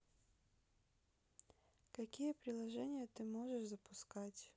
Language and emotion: Russian, neutral